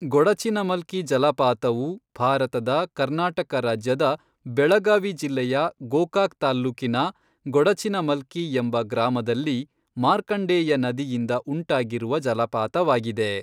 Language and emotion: Kannada, neutral